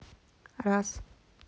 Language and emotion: Russian, neutral